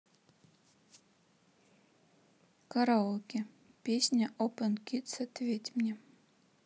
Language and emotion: Russian, neutral